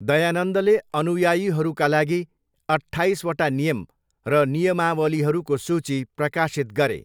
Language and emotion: Nepali, neutral